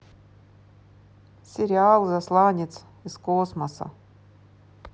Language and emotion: Russian, neutral